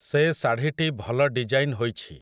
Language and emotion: Odia, neutral